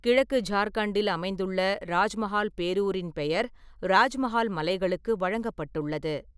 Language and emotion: Tamil, neutral